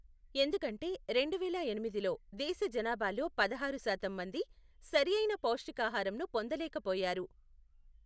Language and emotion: Telugu, neutral